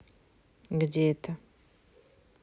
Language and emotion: Russian, neutral